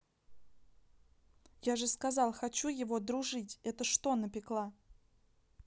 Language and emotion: Russian, angry